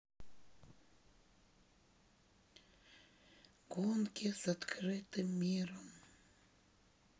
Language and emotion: Russian, sad